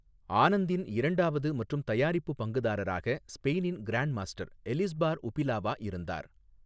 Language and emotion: Tamil, neutral